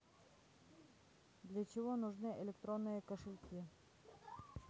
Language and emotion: Russian, neutral